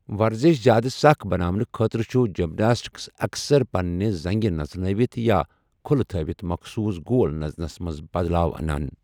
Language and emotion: Kashmiri, neutral